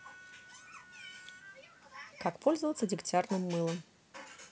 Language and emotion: Russian, neutral